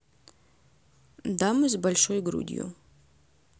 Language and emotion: Russian, neutral